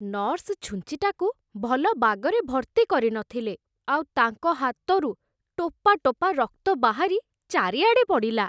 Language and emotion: Odia, disgusted